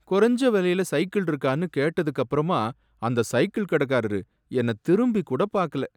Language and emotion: Tamil, sad